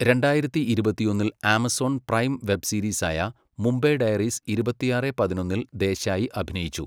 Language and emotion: Malayalam, neutral